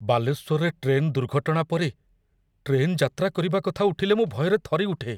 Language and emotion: Odia, fearful